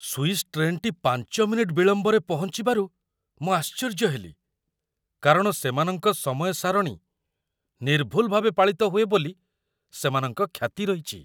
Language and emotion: Odia, surprised